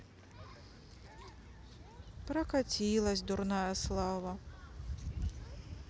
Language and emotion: Russian, sad